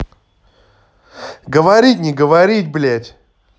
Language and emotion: Russian, angry